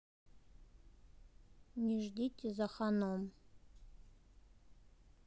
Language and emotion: Russian, neutral